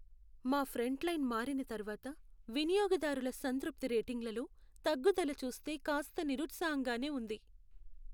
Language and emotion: Telugu, sad